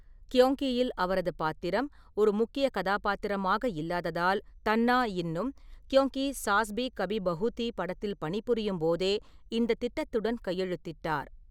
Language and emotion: Tamil, neutral